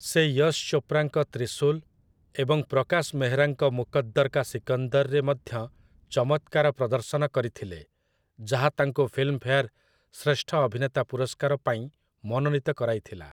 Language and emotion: Odia, neutral